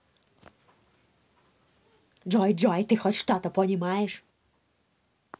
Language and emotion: Russian, angry